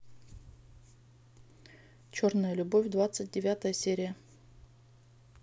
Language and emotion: Russian, neutral